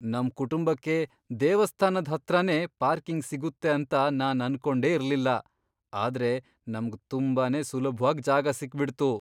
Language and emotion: Kannada, surprised